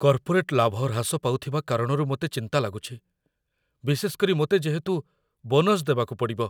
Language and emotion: Odia, fearful